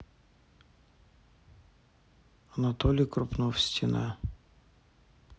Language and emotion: Russian, neutral